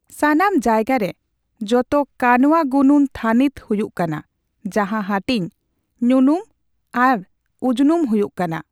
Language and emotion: Santali, neutral